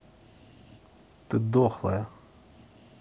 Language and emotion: Russian, angry